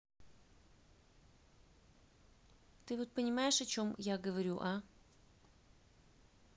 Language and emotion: Russian, neutral